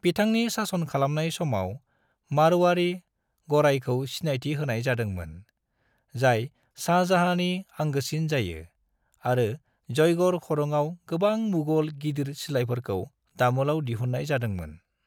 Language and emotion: Bodo, neutral